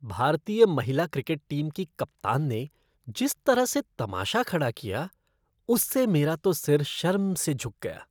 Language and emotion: Hindi, disgusted